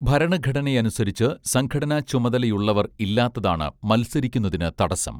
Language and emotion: Malayalam, neutral